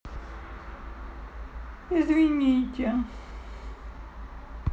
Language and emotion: Russian, sad